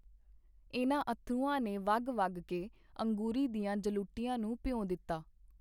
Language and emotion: Punjabi, neutral